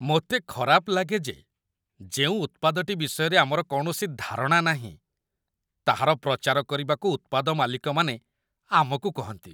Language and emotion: Odia, disgusted